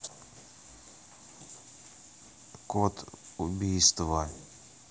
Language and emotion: Russian, neutral